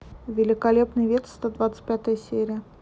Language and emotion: Russian, neutral